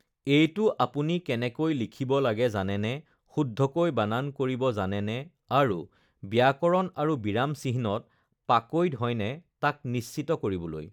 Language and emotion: Assamese, neutral